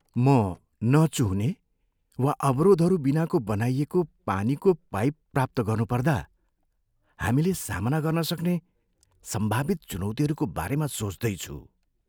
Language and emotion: Nepali, fearful